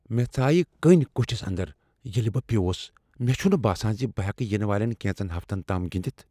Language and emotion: Kashmiri, fearful